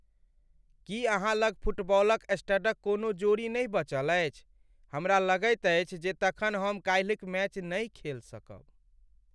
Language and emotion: Maithili, sad